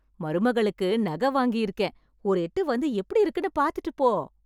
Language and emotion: Tamil, happy